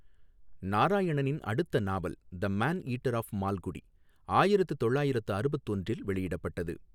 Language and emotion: Tamil, neutral